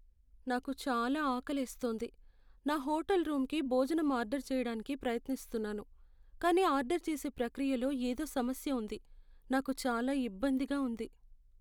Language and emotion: Telugu, sad